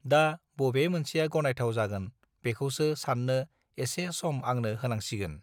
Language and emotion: Bodo, neutral